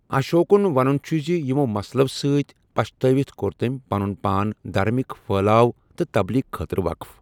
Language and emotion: Kashmiri, neutral